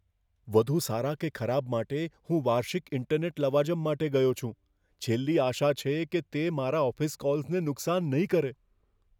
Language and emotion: Gujarati, fearful